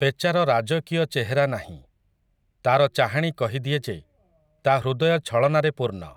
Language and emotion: Odia, neutral